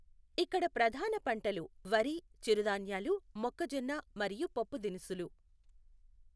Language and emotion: Telugu, neutral